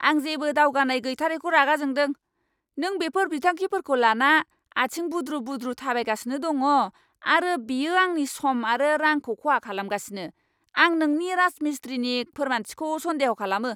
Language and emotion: Bodo, angry